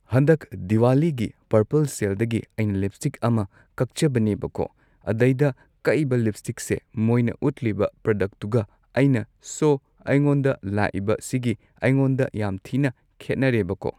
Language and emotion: Manipuri, neutral